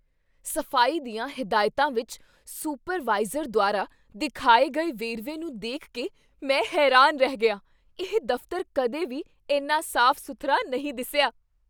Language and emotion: Punjabi, surprised